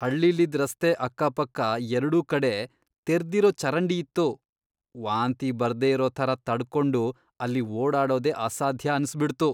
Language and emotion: Kannada, disgusted